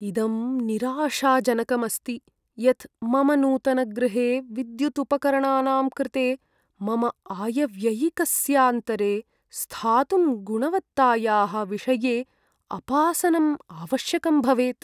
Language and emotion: Sanskrit, sad